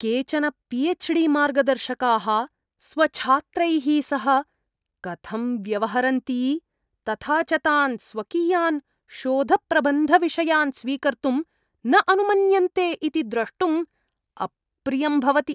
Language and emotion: Sanskrit, disgusted